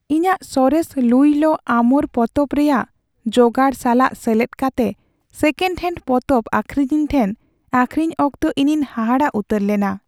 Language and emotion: Santali, sad